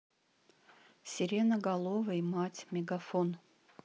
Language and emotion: Russian, neutral